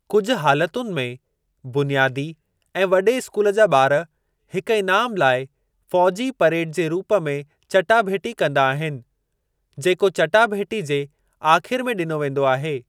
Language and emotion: Sindhi, neutral